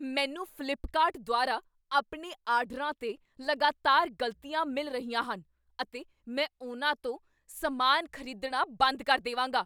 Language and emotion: Punjabi, angry